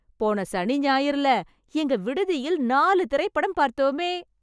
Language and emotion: Tamil, happy